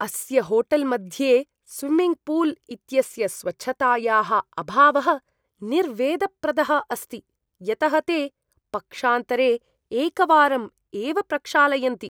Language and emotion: Sanskrit, disgusted